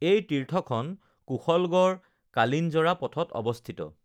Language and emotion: Assamese, neutral